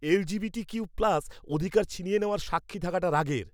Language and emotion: Bengali, angry